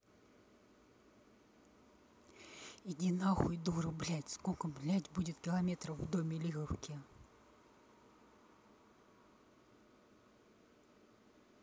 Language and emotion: Russian, angry